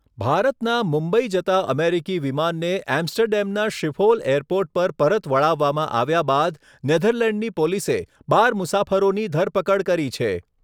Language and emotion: Gujarati, neutral